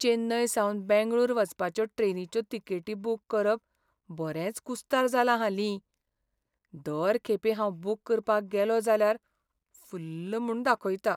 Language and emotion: Goan Konkani, sad